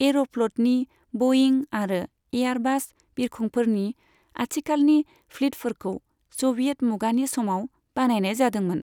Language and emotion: Bodo, neutral